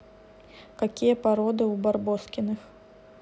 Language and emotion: Russian, neutral